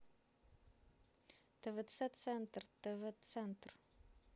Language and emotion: Russian, neutral